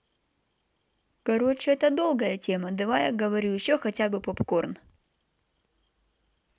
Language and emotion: Russian, neutral